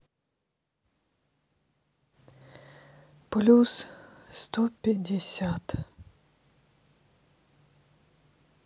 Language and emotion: Russian, sad